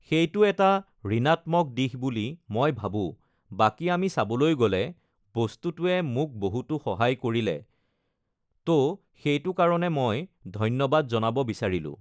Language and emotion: Assamese, neutral